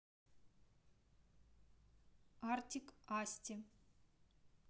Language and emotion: Russian, neutral